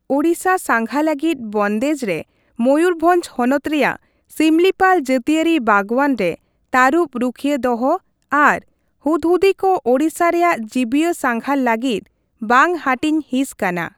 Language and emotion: Santali, neutral